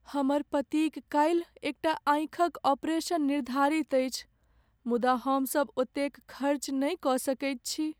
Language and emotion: Maithili, sad